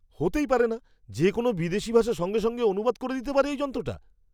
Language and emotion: Bengali, surprised